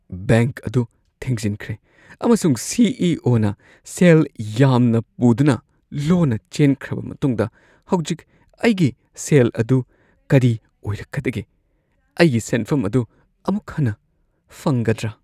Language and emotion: Manipuri, fearful